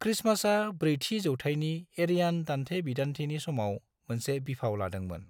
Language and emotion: Bodo, neutral